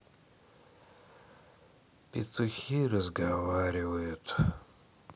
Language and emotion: Russian, sad